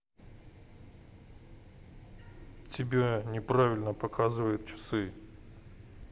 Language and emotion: Russian, neutral